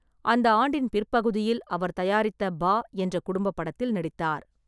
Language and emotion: Tamil, neutral